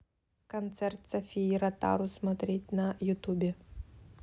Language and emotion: Russian, neutral